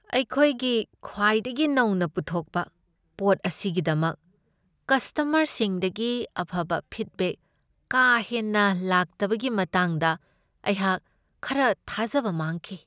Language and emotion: Manipuri, sad